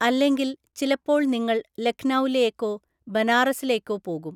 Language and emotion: Malayalam, neutral